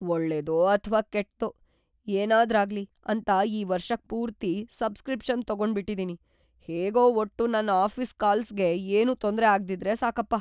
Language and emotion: Kannada, fearful